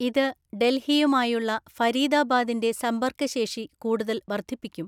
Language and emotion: Malayalam, neutral